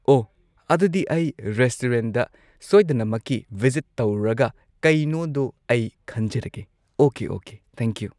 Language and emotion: Manipuri, neutral